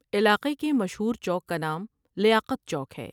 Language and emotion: Urdu, neutral